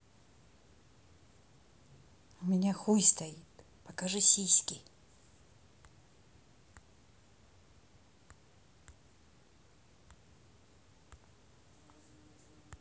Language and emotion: Russian, neutral